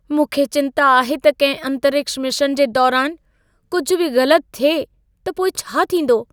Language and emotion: Sindhi, fearful